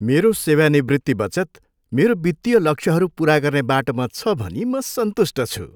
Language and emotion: Nepali, happy